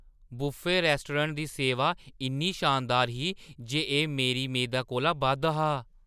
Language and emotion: Dogri, surprised